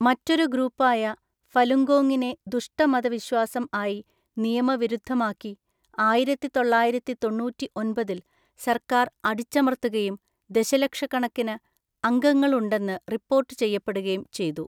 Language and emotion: Malayalam, neutral